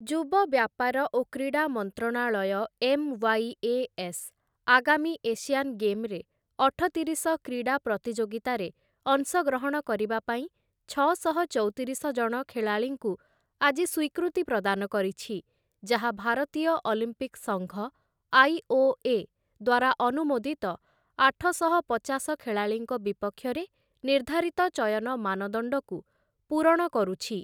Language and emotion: Odia, neutral